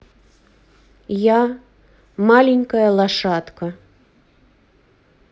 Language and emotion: Russian, neutral